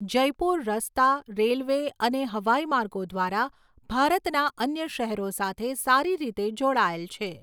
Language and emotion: Gujarati, neutral